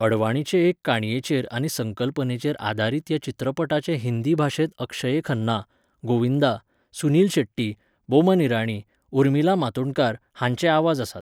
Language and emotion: Goan Konkani, neutral